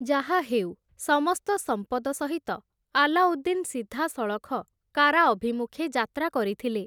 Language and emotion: Odia, neutral